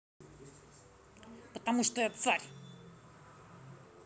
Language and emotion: Russian, angry